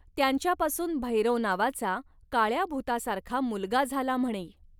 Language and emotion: Marathi, neutral